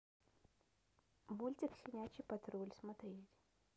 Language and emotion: Russian, neutral